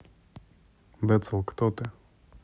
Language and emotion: Russian, neutral